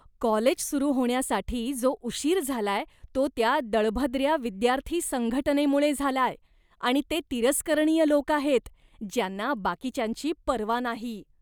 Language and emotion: Marathi, disgusted